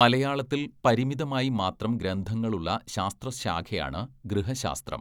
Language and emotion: Malayalam, neutral